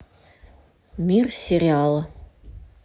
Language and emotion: Russian, neutral